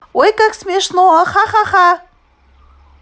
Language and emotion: Russian, positive